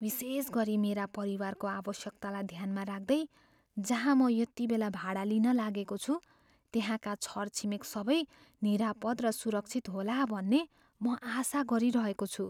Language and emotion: Nepali, fearful